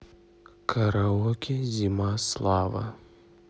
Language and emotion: Russian, neutral